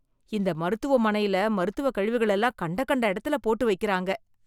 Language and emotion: Tamil, disgusted